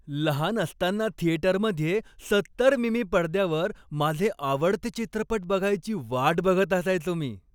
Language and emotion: Marathi, happy